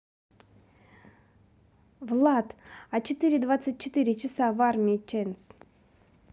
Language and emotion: Russian, neutral